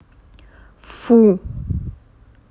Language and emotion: Russian, angry